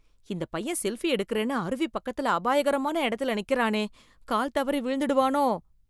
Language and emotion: Tamil, fearful